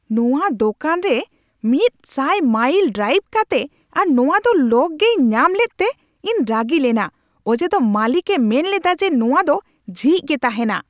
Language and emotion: Santali, angry